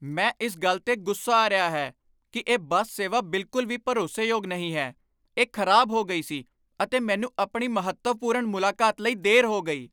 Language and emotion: Punjabi, angry